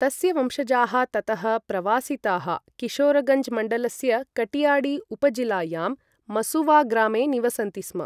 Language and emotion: Sanskrit, neutral